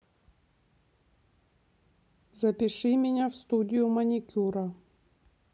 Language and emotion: Russian, neutral